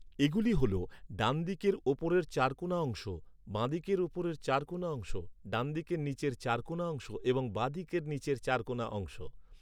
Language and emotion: Bengali, neutral